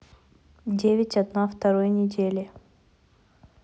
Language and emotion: Russian, neutral